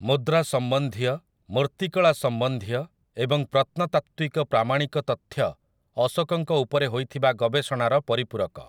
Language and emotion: Odia, neutral